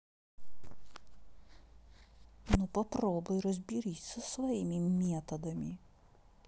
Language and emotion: Russian, angry